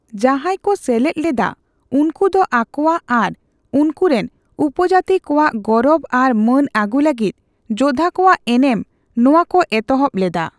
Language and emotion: Santali, neutral